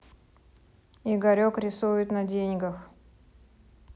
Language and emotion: Russian, neutral